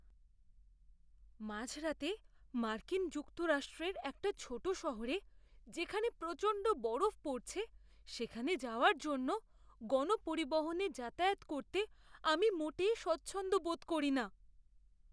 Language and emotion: Bengali, fearful